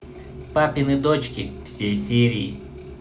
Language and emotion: Russian, neutral